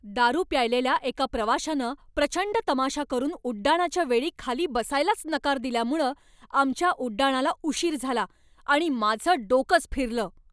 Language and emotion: Marathi, angry